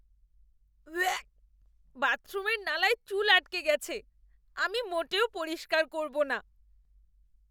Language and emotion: Bengali, disgusted